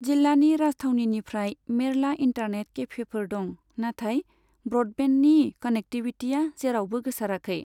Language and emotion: Bodo, neutral